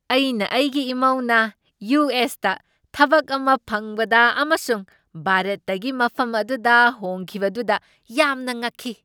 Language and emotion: Manipuri, surprised